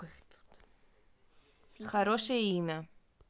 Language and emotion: Russian, neutral